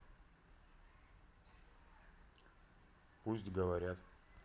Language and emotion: Russian, neutral